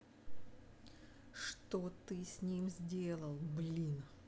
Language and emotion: Russian, angry